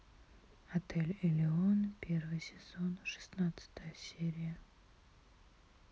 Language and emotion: Russian, neutral